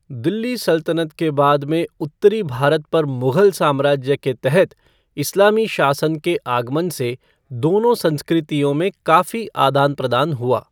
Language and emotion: Hindi, neutral